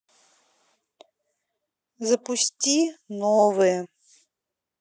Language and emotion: Russian, neutral